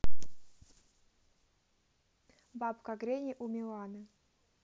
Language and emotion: Russian, neutral